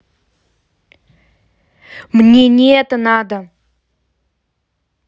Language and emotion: Russian, angry